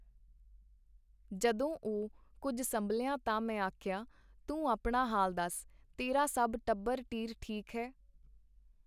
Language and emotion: Punjabi, neutral